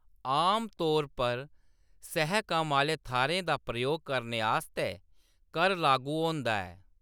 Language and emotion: Dogri, neutral